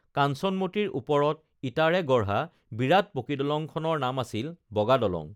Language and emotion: Assamese, neutral